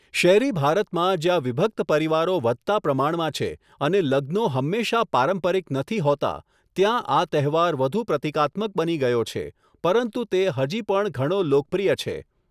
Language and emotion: Gujarati, neutral